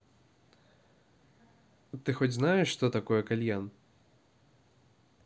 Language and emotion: Russian, neutral